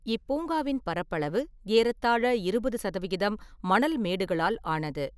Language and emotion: Tamil, neutral